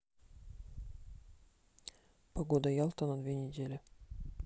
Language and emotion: Russian, neutral